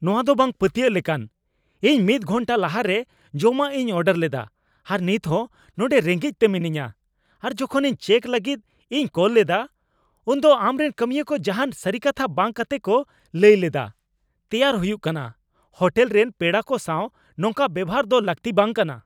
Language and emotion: Santali, angry